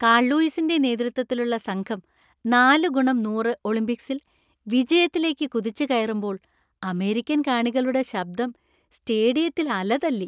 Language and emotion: Malayalam, happy